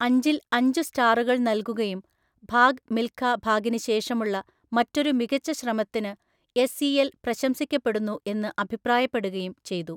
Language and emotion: Malayalam, neutral